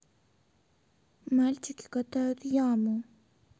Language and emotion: Russian, sad